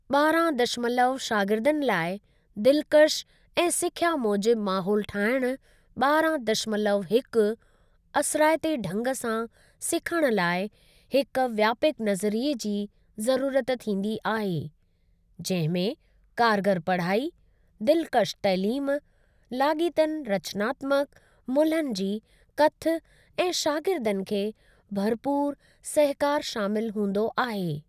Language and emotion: Sindhi, neutral